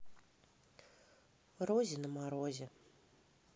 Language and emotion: Russian, neutral